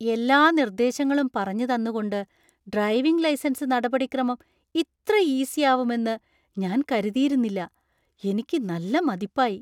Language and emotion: Malayalam, surprised